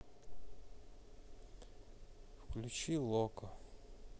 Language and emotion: Russian, sad